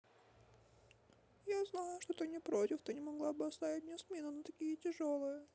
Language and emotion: Russian, sad